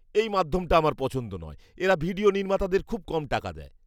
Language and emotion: Bengali, disgusted